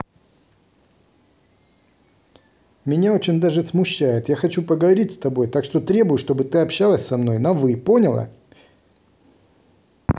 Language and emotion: Russian, angry